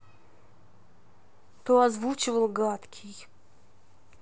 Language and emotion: Russian, neutral